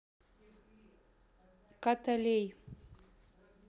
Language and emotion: Russian, neutral